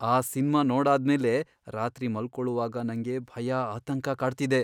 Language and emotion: Kannada, fearful